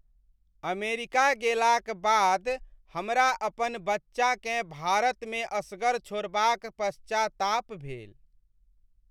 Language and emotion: Maithili, sad